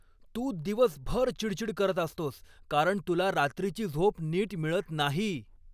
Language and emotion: Marathi, angry